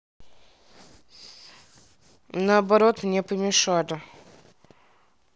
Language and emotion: Russian, neutral